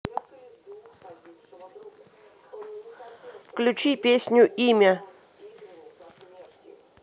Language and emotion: Russian, neutral